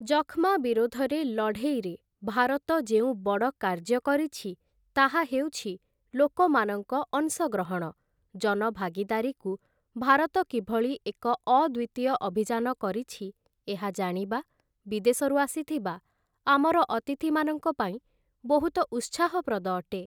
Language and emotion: Odia, neutral